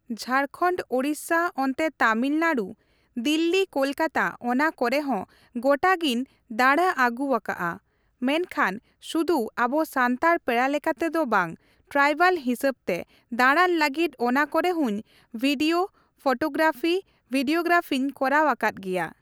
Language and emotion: Santali, neutral